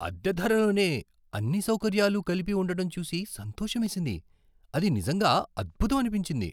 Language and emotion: Telugu, surprised